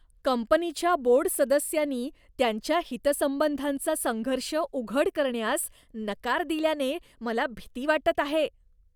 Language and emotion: Marathi, disgusted